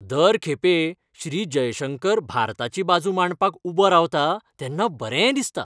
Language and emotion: Goan Konkani, happy